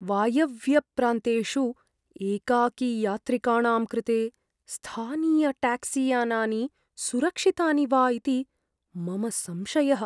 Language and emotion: Sanskrit, fearful